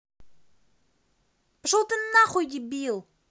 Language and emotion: Russian, angry